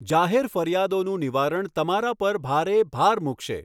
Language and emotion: Gujarati, neutral